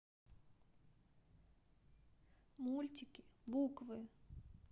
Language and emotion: Russian, sad